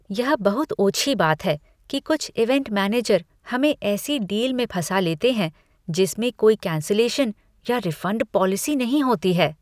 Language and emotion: Hindi, disgusted